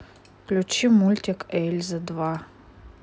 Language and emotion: Russian, neutral